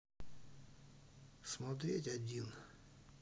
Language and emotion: Russian, neutral